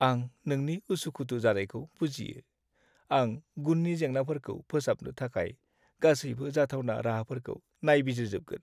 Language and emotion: Bodo, sad